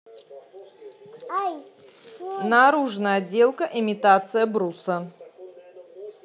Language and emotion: Russian, neutral